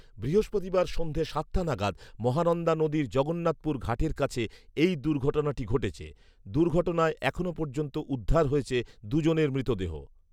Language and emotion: Bengali, neutral